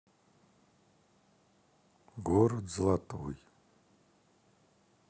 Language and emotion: Russian, sad